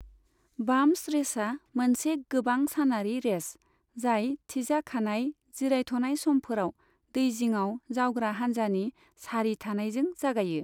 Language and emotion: Bodo, neutral